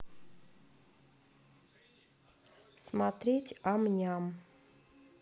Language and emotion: Russian, neutral